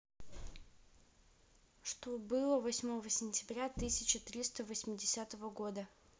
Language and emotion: Russian, neutral